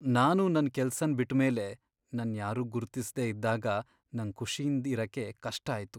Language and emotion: Kannada, sad